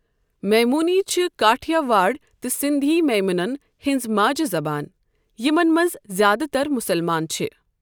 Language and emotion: Kashmiri, neutral